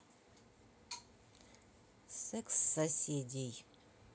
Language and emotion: Russian, neutral